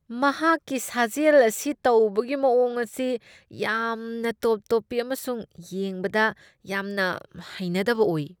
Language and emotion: Manipuri, disgusted